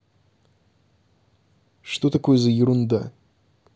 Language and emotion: Russian, neutral